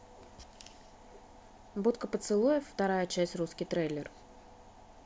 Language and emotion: Russian, neutral